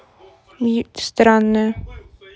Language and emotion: Russian, neutral